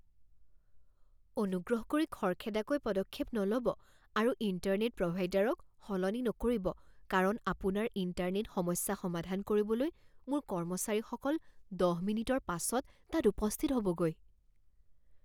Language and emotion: Assamese, fearful